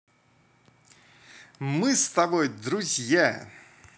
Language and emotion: Russian, positive